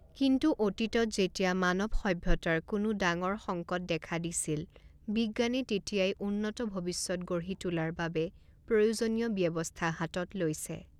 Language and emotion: Assamese, neutral